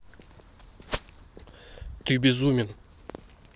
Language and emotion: Russian, neutral